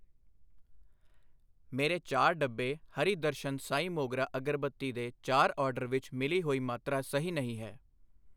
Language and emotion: Punjabi, neutral